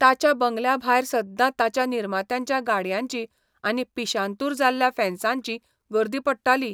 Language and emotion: Goan Konkani, neutral